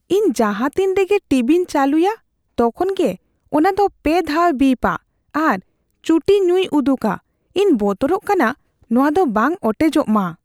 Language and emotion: Santali, fearful